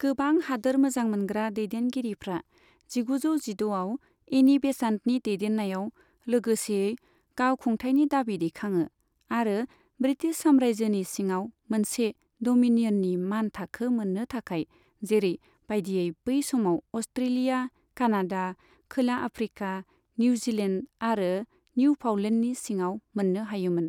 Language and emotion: Bodo, neutral